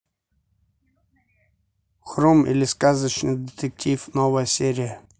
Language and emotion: Russian, neutral